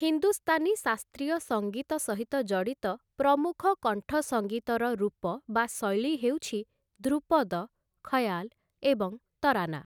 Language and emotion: Odia, neutral